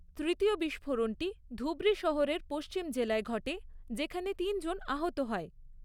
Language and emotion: Bengali, neutral